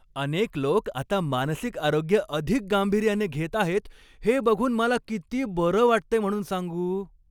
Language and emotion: Marathi, happy